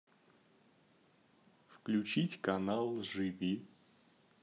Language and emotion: Russian, neutral